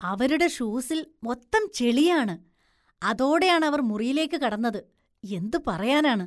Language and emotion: Malayalam, disgusted